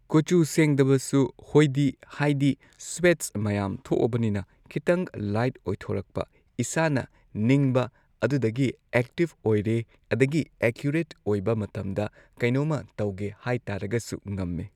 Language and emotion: Manipuri, neutral